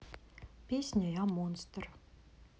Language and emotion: Russian, neutral